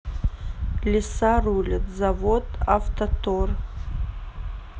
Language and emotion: Russian, neutral